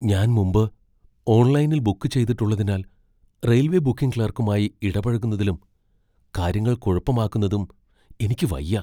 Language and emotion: Malayalam, fearful